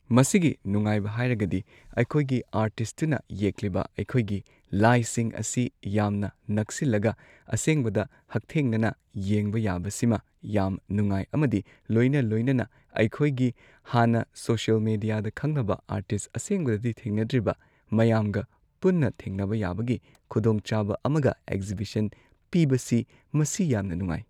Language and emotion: Manipuri, neutral